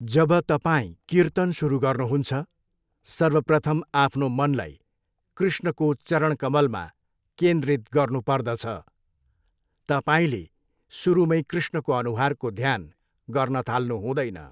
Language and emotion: Nepali, neutral